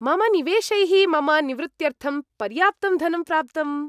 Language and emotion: Sanskrit, happy